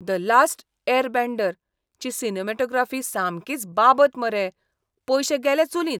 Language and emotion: Goan Konkani, disgusted